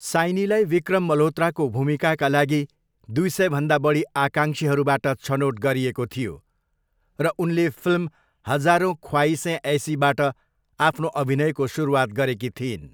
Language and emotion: Nepali, neutral